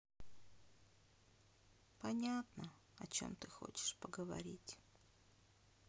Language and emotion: Russian, sad